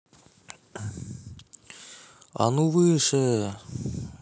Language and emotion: Russian, neutral